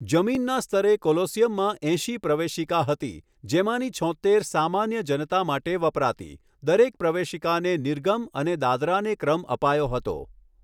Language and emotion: Gujarati, neutral